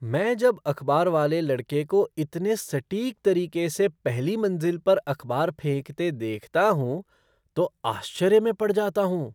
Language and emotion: Hindi, surprised